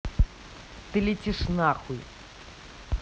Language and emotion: Russian, angry